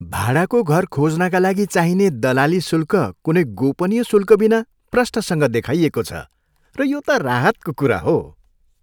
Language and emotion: Nepali, happy